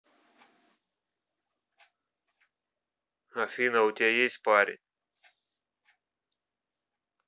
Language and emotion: Russian, neutral